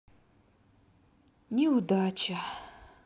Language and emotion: Russian, sad